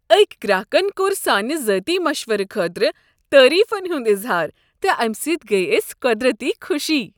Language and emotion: Kashmiri, happy